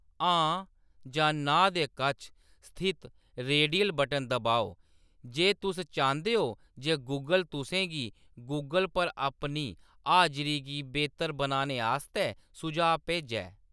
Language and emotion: Dogri, neutral